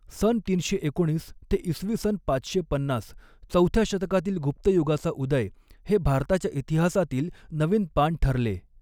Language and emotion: Marathi, neutral